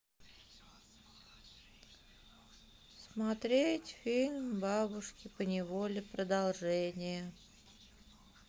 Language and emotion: Russian, sad